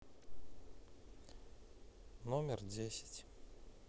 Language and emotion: Russian, neutral